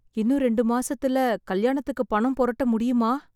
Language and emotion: Tamil, sad